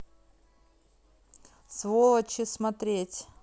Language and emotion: Russian, neutral